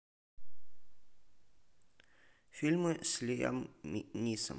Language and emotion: Russian, neutral